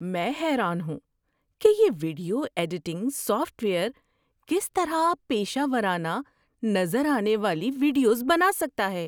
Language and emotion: Urdu, surprised